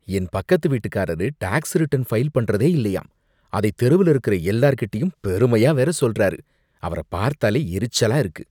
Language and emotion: Tamil, disgusted